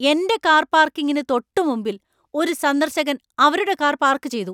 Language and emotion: Malayalam, angry